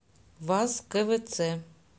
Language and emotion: Russian, neutral